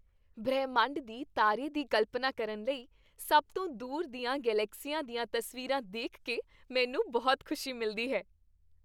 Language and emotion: Punjabi, happy